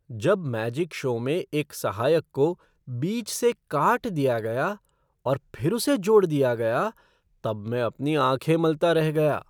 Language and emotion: Hindi, surprised